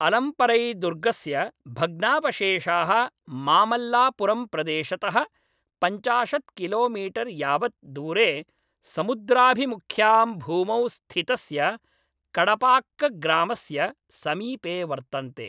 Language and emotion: Sanskrit, neutral